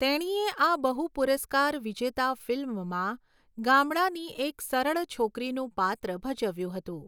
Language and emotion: Gujarati, neutral